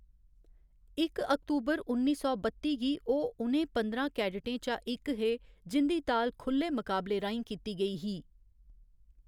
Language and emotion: Dogri, neutral